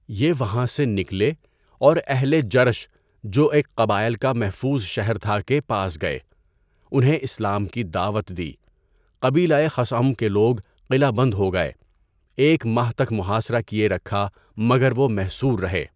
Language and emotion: Urdu, neutral